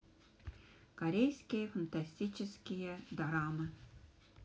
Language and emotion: Russian, neutral